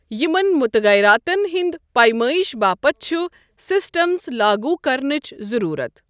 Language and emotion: Kashmiri, neutral